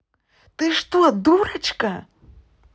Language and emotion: Russian, angry